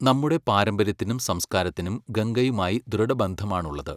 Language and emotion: Malayalam, neutral